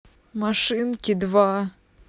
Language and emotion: Russian, sad